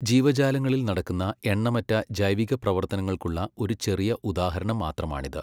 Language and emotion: Malayalam, neutral